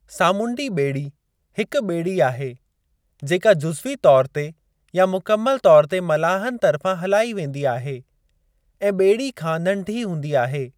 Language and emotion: Sindhi, neutral